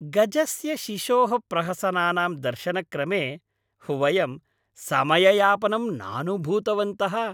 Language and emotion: Sanskrit, happy